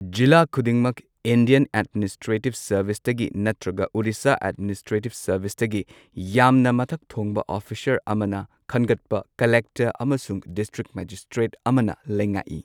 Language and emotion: Manipuri, neutral